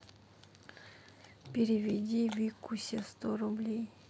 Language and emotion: Russian, sad